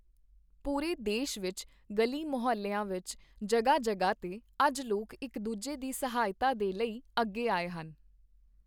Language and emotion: Punjabi, neutral